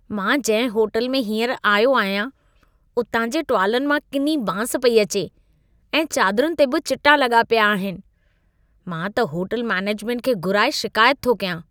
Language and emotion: Sindhi, disgusted